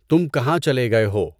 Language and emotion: Urdu, neutral